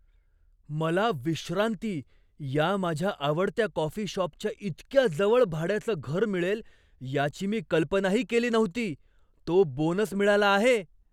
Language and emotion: Marathi, surprised